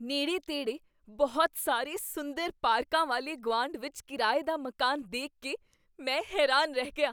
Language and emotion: Punjabi, surprised